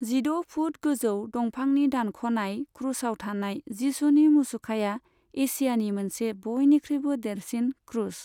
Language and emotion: Bodo, neutral